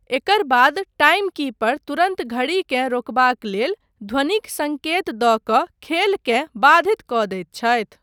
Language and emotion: Maithili, neutral